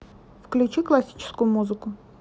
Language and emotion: Russian, neutral